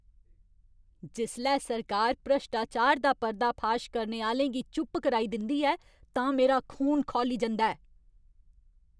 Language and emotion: Dogri, angry